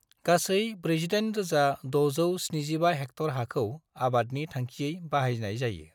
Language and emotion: Bodo, neutral